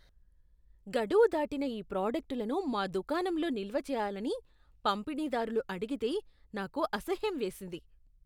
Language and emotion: Telugu, disgusted